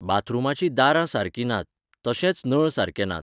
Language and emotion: Goan Konkani, neutral